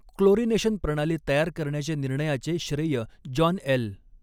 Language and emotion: Marathi, neutral